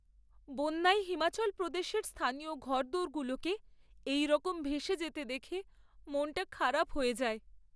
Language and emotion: Bengali, sad